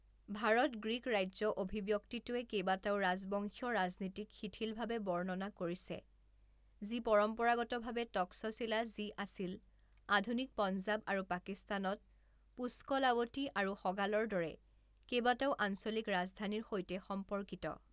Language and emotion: Assamese, neutral